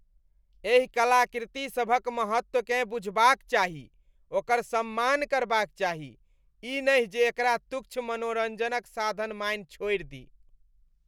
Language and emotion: Maithili, disgusted